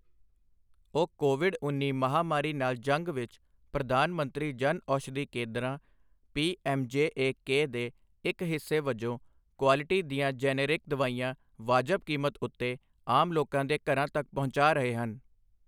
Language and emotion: Punjabi, neutral